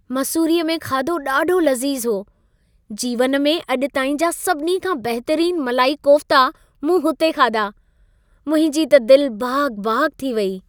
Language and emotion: Sindhi, happy